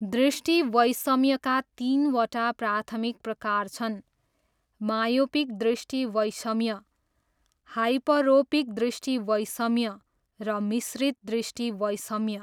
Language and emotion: Nepali, neutral